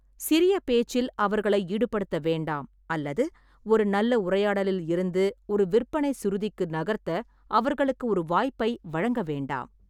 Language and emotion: Tamil, neutral